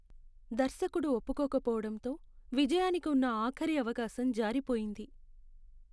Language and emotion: Telugu, sad